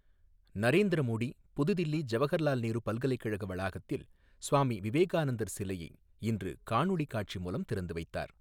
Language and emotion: Tamil, neutral